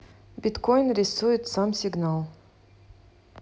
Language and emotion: Russian, neutral